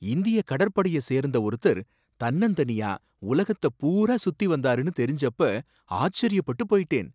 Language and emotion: Tamil, surprised